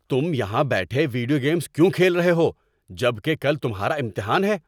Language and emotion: Urdu, angry